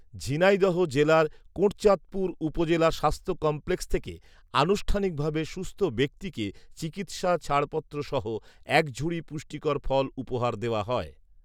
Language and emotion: Bengali, neutral